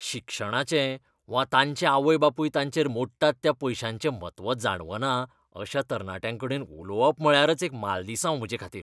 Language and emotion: Goan Konkani, disgusted